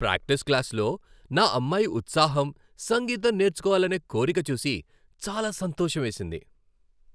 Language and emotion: Telugu, happy